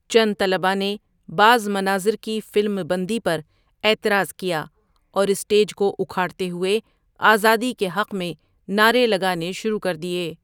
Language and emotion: Urdu, neutral